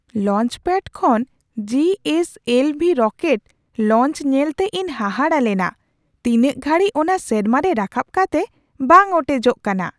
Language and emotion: Santali, surprised